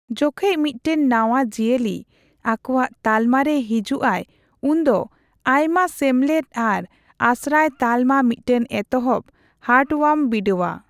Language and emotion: Santali, neutral